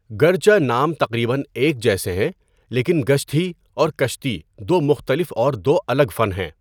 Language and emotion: Urdu, neutral